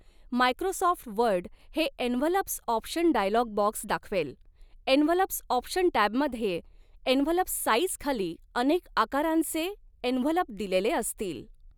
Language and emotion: Marathi, neutral